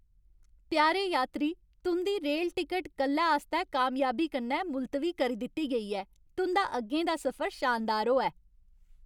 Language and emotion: Dogri, happy